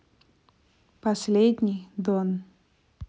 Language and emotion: Russian, neutral